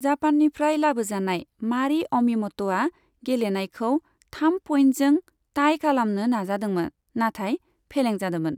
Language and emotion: Bodo, neutral